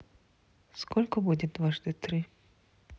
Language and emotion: Russian, neutral